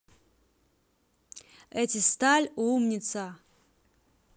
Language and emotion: Russian, positive